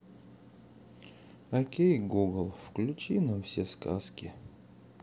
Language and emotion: Russian, sad